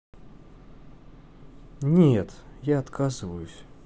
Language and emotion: Russian, neutral